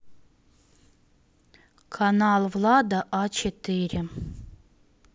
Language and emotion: Russian, neutral